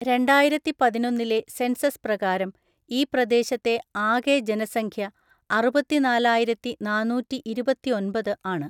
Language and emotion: Malayalam, neutral